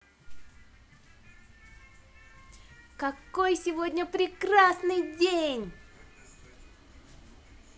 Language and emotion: Russian, positive